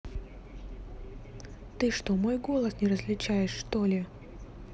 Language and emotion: Russian, angry